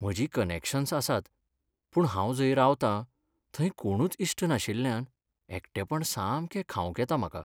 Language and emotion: Goan Konkani, sad